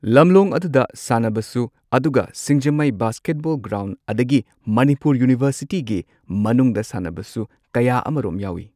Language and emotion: Manipuri, neutral